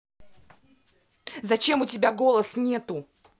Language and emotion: Russian, angry